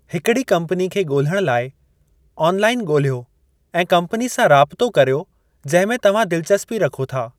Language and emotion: Sindhi, neutral